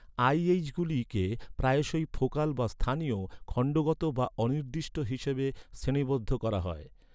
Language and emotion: Bengali, neutral